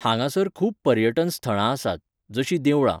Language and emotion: Goan Konkani, neutral